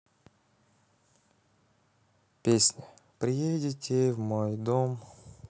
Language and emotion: Russian, neutral